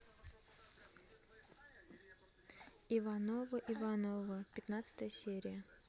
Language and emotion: Russian, neutral